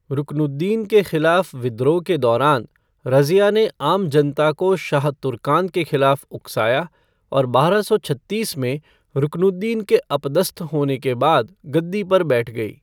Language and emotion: Hindi, neutral